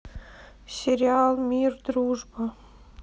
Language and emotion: Russian, sad